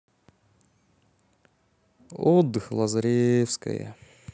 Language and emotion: Russian, sad